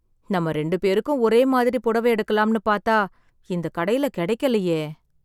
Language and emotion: Tamil, sad